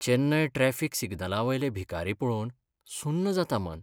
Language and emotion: Goan Konkani, sad